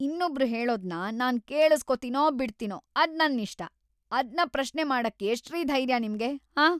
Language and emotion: Kannada, angry